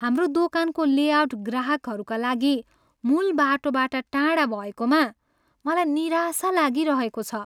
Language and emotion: Nepali, sad